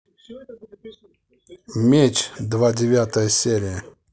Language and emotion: Russian, neutral